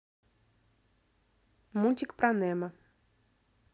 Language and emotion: Russian, neutral